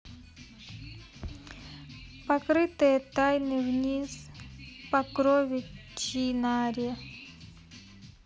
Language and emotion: Russian, neutral